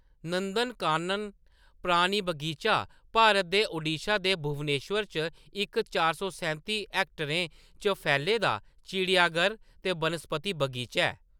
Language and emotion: Dogri, neutral